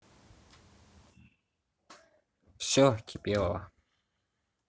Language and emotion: Russian, neutral